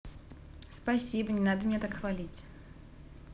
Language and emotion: Russian, positive